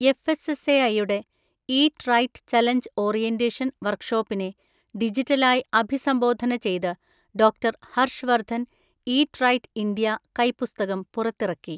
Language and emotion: Malayalam, neutral